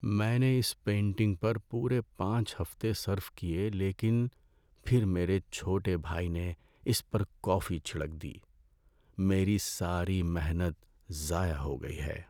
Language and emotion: Urdu, sad